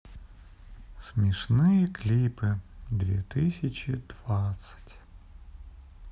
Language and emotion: Russian, sad